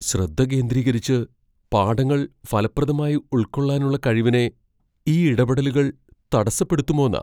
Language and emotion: Malayalam, fearful